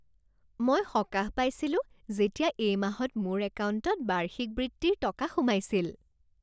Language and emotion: Assamese, happy